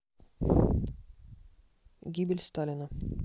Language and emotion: Russian, neutral